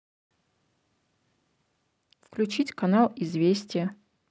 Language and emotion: Russian, neutral